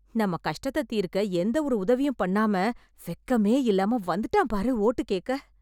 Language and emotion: Tamil, disgusted